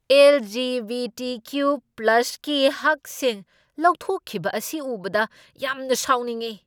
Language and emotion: Manipuri, angry